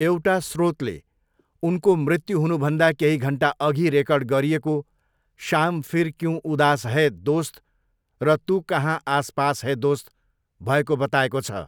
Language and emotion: Nepali, neutral